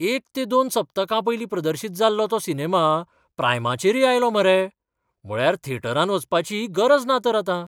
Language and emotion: Goan Konkani, surprised